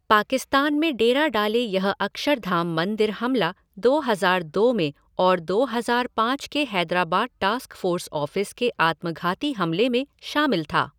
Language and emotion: Hindi, neutral